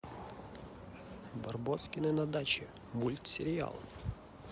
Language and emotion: Russian, positive